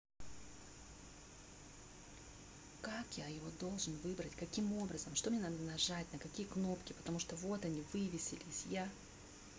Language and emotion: Russian, angry